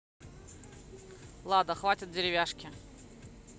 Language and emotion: Russian, neutral